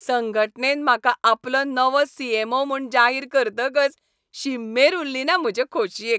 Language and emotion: Goan Konkani, happy